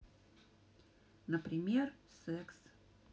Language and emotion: Russian, neutral